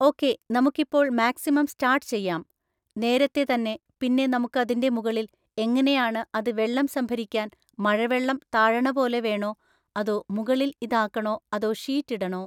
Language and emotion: Malayalam, neutral